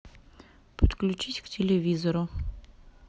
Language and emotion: Russian, neutral